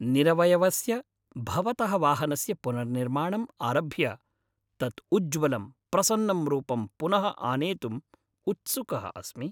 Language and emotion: Sanskrit, happy